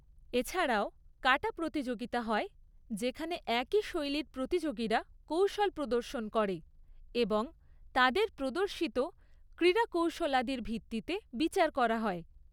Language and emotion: Bengali, neutral